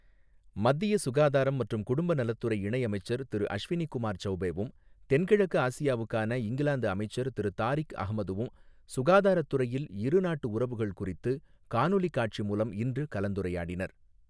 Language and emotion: Tamil, neutral